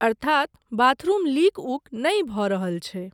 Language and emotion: Maithili, neutral